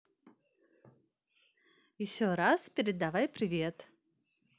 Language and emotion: Russian, positive